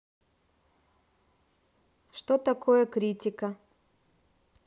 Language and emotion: Russian, neutral